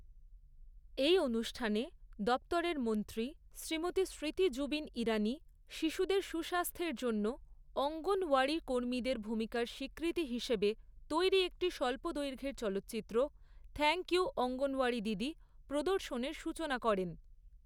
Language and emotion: Bengali, neutral